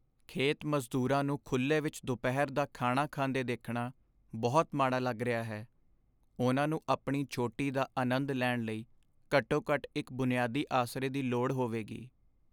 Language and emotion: Punjabi, sad